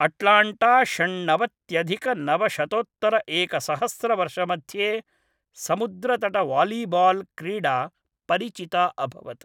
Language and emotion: Sanskrit, neutral